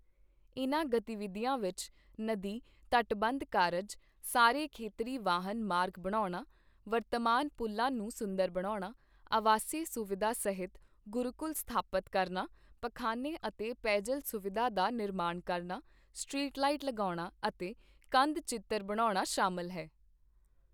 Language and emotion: Punjabi, neutral